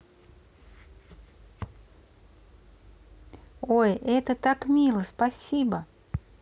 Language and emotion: Russian, positive